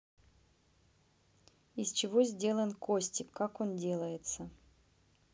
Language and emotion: Russian, neutral